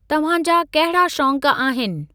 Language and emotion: Sindhi, neutral